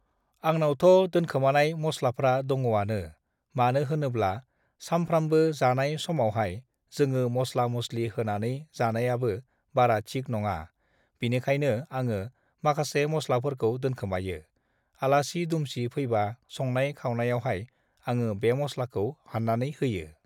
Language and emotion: Bodo, neutral